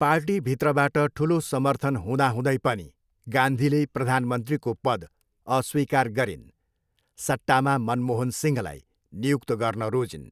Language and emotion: Nepali, neutral